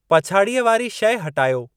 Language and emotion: Sindhi, neutral